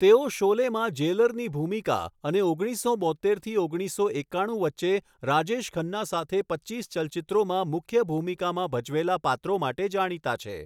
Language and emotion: Gujarati, neutral